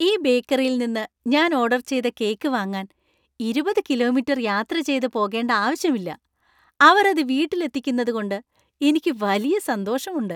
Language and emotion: Malayalam, happy